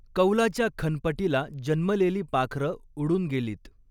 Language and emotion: Marathi, neutral